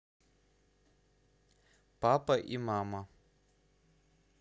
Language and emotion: Russian, neutral